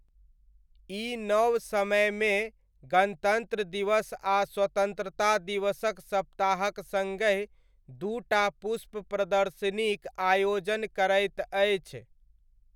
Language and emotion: Maithili, neutral